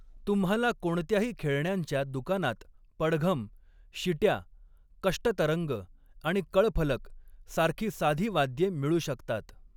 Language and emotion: Marathi, neutral